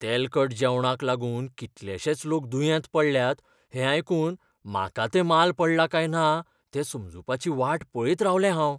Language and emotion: Goan Konkani, fearful